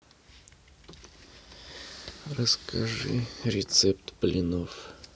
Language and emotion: Russian, sad